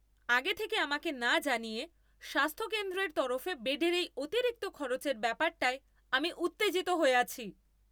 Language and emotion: Bengali, angry